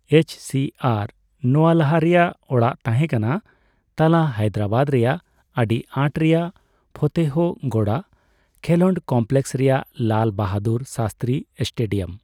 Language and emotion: Santali, neutral